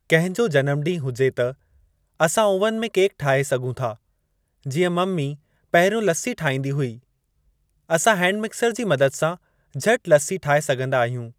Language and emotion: Sindhi, neutral